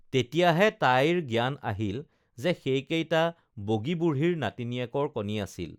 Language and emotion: Assamese, neutral